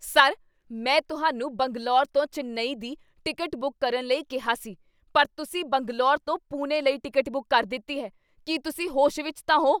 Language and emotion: Punjabi, angry